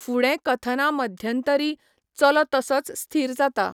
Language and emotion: Goan Konkani, neutral